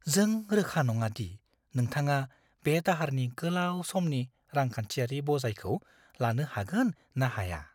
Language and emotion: Bodo, fearful